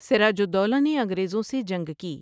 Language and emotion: Urdu, neutral